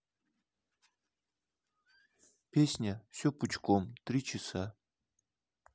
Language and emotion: Russian, neutral